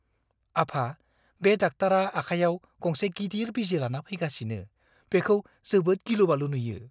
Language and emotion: Bodo, fearful